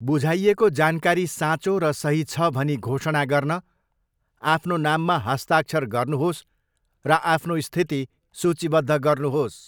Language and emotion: Nepali, neutral